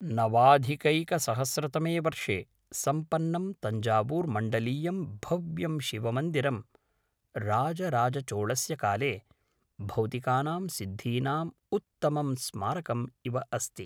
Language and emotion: Sanskrit, neutral